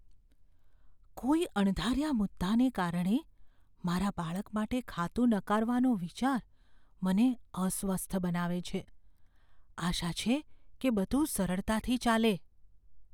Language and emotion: Gujarati, fearful